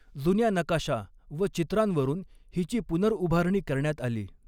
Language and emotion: Marathi, neutral